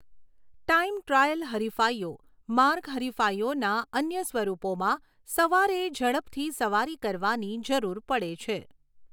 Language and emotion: Gujarati, neutral